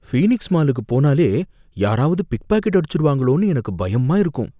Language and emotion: Tamil, fearful